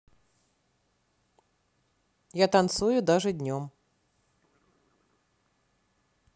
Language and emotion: Russian, neutral